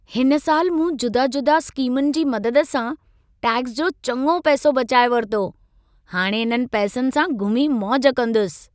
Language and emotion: Sindhi, happy